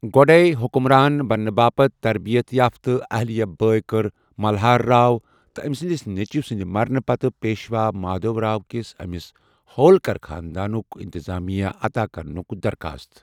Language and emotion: Kashmiri, neutral